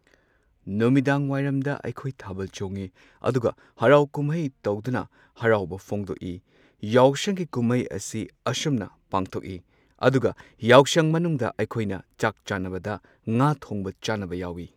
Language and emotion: Manipuri, neutral